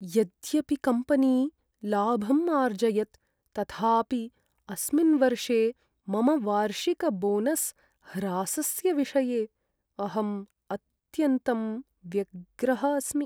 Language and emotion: Sanskrit, sad